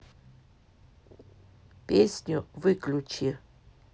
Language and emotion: Russian, neutral